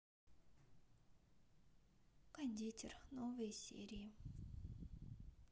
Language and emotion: Russian, sad